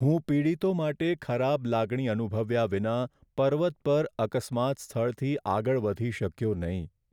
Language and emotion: Gujarati, sad